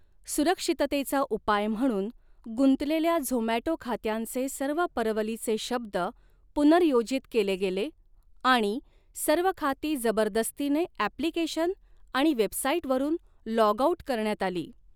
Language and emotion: Marathi, neutral